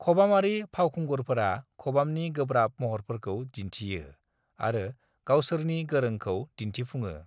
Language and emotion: Bodo, neutral